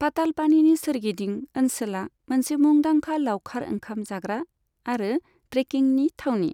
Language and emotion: Bodo, neutral